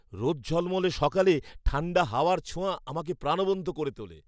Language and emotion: Bengali, happy